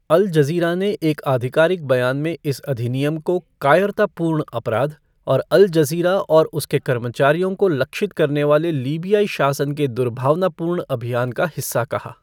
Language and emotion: Hindi, neutral